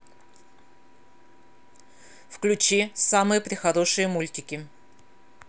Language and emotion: Russian, angry